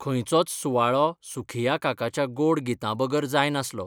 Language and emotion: Goan Konkani, neutral